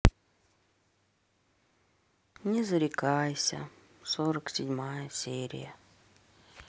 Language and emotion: Russian, sad